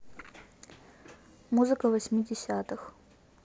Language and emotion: Russian, neutral